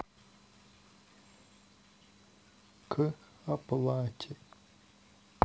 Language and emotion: Russian, sad